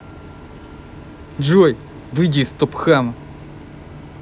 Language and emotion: Russian, angry